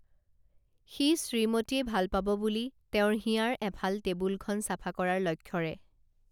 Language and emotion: Assamese, neutral